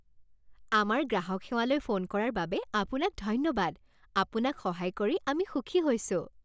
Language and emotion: Assamese, happy